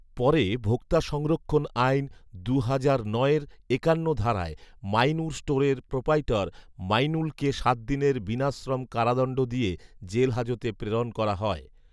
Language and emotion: Bengali, neutral